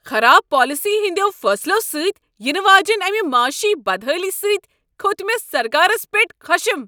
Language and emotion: Kashmiri, angry